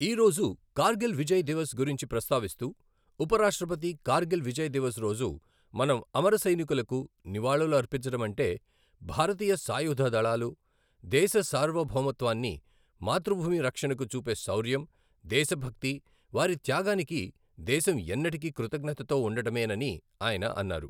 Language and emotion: Telugu, neutral